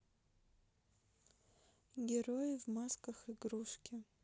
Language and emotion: Russian, neutral